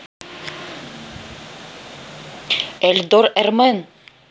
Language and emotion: Russian, neutral